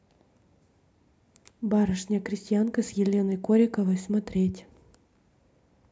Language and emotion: Russian, neutral